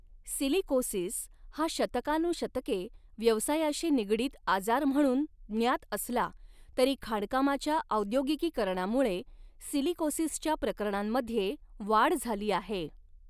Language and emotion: Marathi, neutral